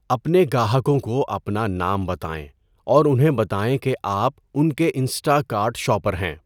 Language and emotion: Urdu, neutral